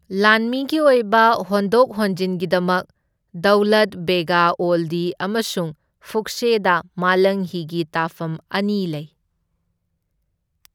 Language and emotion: Manipuri, neutral